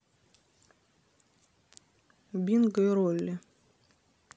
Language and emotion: Russian, neutral